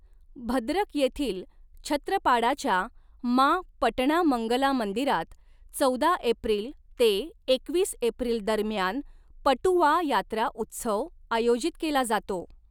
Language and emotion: Marathi, neutral